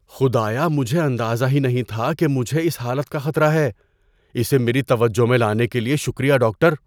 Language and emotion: Urdu, surprised